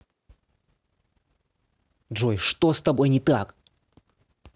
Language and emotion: Russian, angry